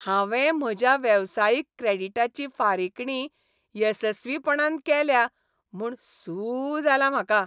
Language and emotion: Goan Konkani, happy